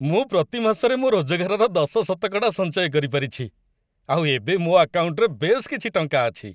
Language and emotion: Odia, happy